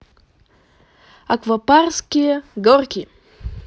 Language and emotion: Russian, positive